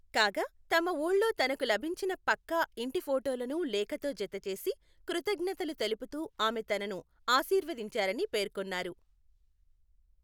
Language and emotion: Telugu, neutral